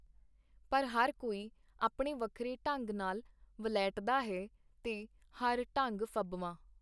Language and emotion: Punjabi, neutral